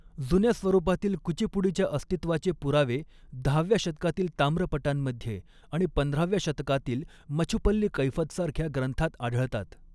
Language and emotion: Marathi, neutral